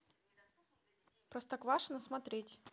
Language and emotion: Russian, neutral